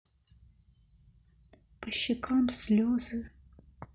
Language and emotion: Russian, sad